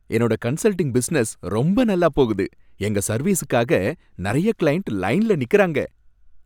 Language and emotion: Tamil, happy